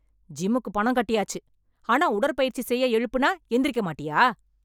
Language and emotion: Tamil, angry